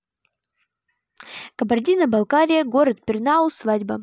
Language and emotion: Russian, neutral